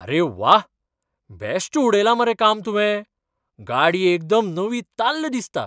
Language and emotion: Goan Konkani, surprised